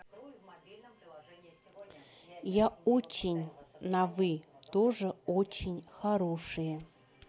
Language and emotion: Russian, neutral